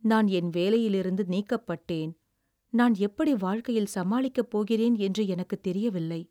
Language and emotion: Tamil, sad